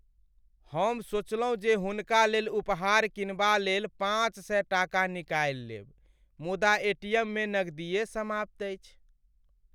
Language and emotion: Maithili, sad